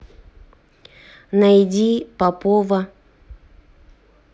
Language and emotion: Russian, neutral